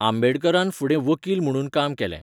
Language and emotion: Goan Konkani, neutral